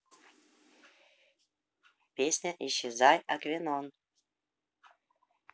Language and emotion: Russian, neutral